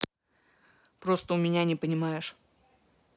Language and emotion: Russian, neutral